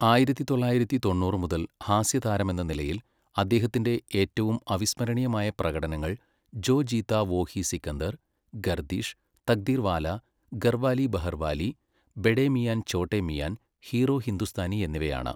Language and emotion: Malayalam, neutral